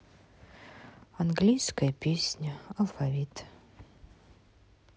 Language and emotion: Russian, sad